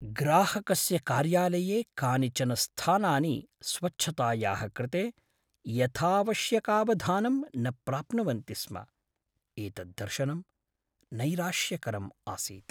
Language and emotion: Sanskrit, sad